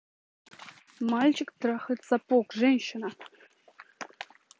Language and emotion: Russian, neutral